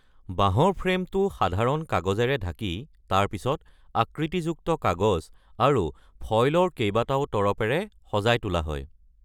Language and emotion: Assamese, neutral